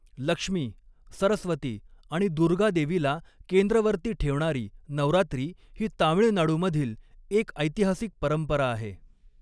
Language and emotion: Marathi, neutral